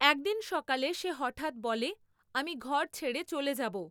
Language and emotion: Bengali, neutral